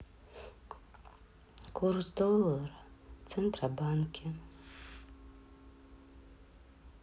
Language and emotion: Russian, sad